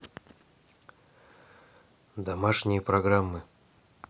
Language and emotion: Russian, neutral